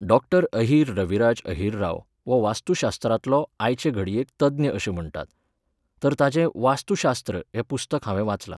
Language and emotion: Goan Konkani, neutral